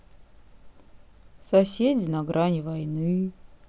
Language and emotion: Russian, sad